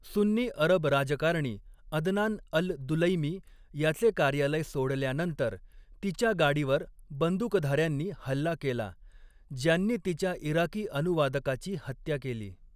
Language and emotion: Marathi, neutral